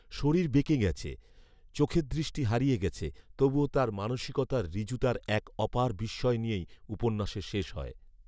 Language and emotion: Bengali, neutral